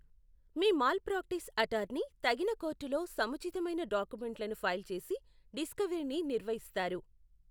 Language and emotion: Telugu, neutral